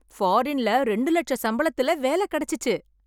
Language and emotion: Tamil, happy